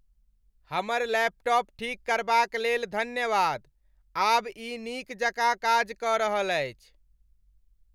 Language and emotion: Maithili, happy